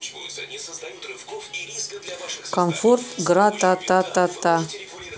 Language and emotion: Russian, neutral